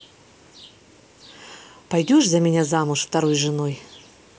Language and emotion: Russian, neutral